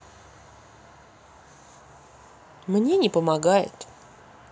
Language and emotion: Russian, neutral